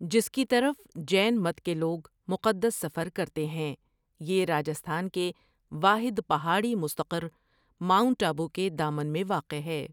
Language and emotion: Urdu, neutral